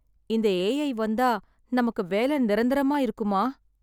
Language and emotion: Tamil, sad